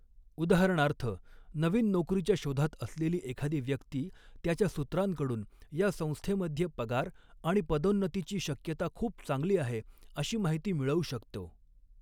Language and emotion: Marathi, neutral